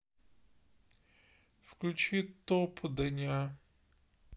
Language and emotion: Russian, sad